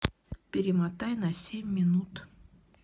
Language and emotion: Russian, neutral